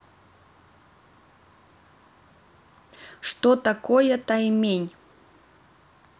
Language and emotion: Russian, neutral